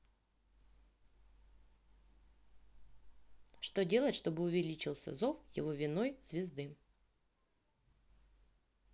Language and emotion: Russian, neutral